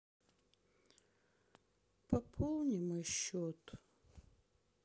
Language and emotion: Russian, sad